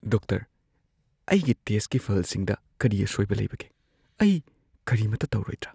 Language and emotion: Manipuri, fearful